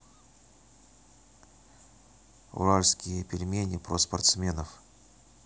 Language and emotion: Russian, neutral